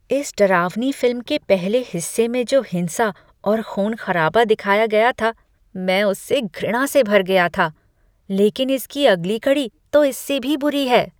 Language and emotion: Hindi, disgusted